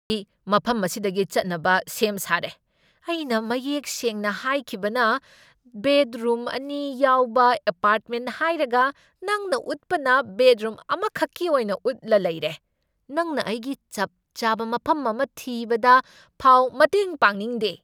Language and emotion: Manipuri, angry